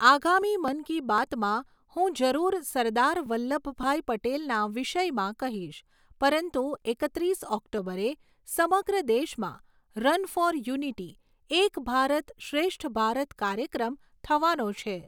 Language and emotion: Gujarati, neutral